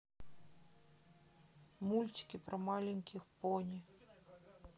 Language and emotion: Russian, sad